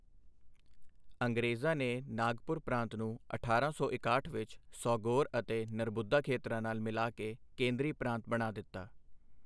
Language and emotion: Punjabi, neutral